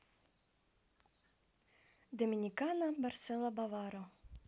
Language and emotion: Russian, positive